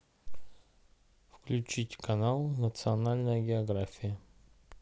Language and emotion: Russian, neutral